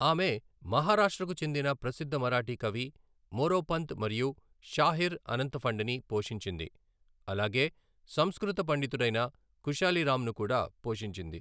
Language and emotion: Telugu, neutral